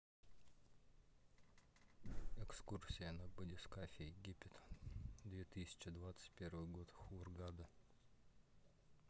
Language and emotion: Russian, neutral